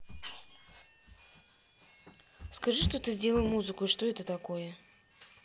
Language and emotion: Russian, neutral